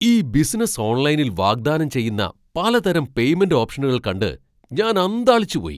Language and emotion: Malayalam, surprised